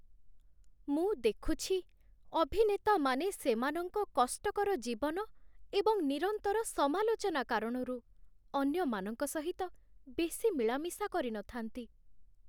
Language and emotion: Odia, sad